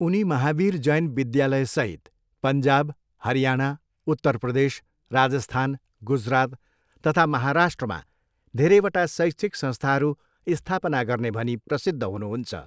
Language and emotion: Nepali, neutral